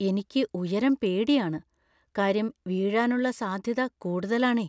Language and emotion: Malayalam, fearful